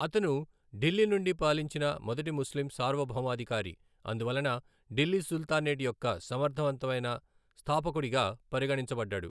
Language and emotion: Telugu, neutral